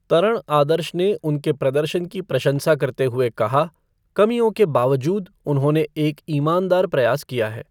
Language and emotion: Hindi, neutral